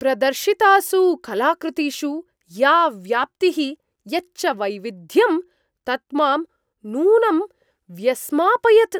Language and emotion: Sanskrit, surprised